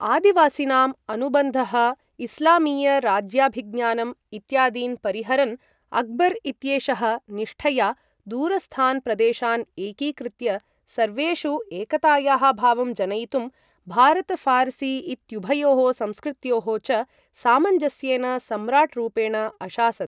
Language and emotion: Sanskrit, neutral